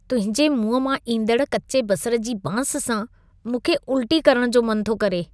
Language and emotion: Sindhi, disgusted